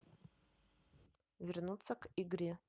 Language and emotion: Russian, neutral